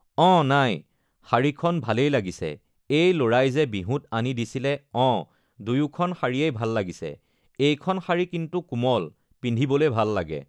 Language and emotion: Assamese, neutral